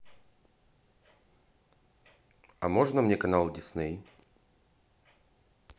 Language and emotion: Russian, neutral